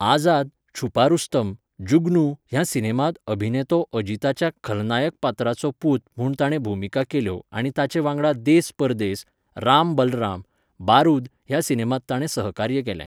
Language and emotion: Goan Konkani, neutral